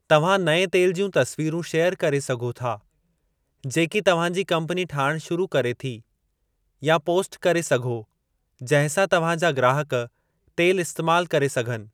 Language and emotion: Sindhi, neutral